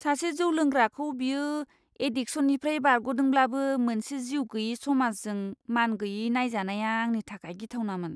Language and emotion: Bodo, disgusted